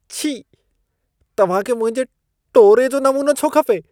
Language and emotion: Sindhi, disgusted